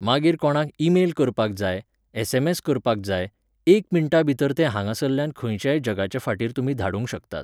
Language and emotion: Goan Konkani, neutral